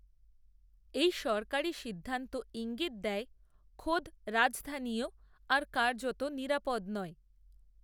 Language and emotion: Bengali, neutral